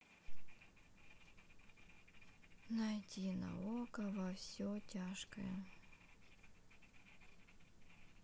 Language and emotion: Russian, sad